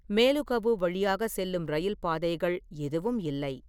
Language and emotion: Tamil, neutral